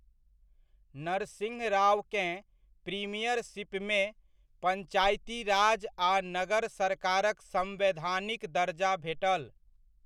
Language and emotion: Maithili, neutral